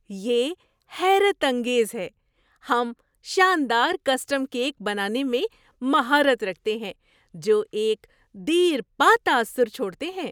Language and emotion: Urdu, surprised